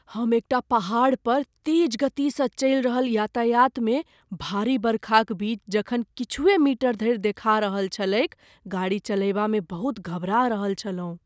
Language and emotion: Maithili, fearful